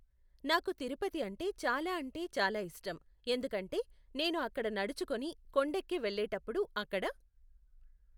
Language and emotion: Telugu, neutral